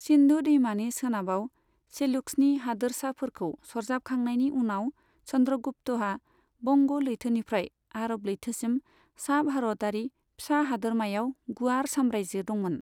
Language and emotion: Bodo, neutral